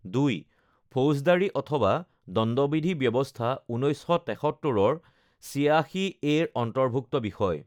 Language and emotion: Assamese, neutral